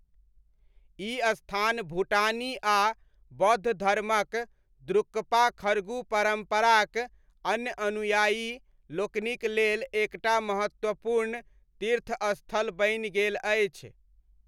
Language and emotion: Maithili, neutral